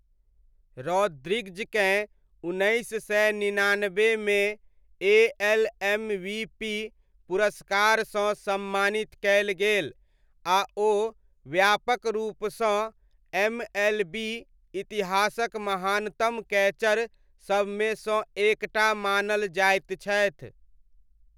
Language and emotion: Maithili, neutral